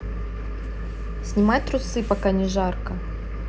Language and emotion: Russian, neutral